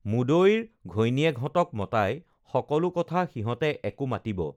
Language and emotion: Assamese, neutral